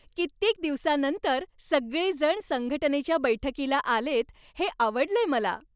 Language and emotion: Marathi, happy